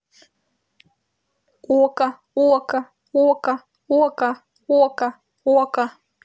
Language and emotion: Russian, neutral